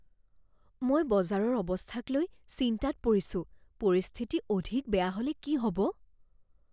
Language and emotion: Assamese, fearful